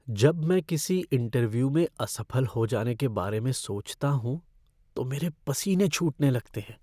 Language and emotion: Hindi, fearful